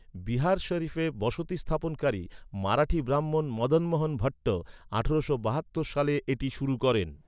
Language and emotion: Bengali, neutral